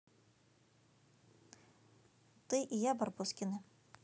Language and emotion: Russian, neutral